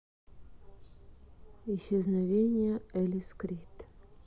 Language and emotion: Russian, neutral